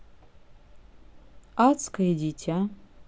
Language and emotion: Russian, neutral